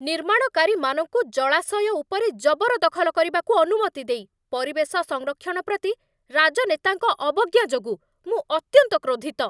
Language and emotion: Odia, angry